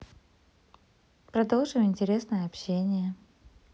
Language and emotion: Russian, neutral